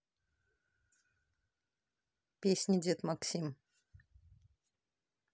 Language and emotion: Russian, neutral